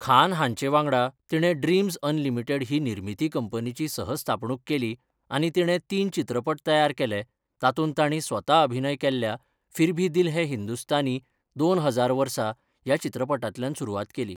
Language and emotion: Goan Konkani, neutral